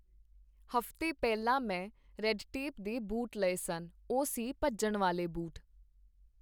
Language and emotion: Punjabi, neutral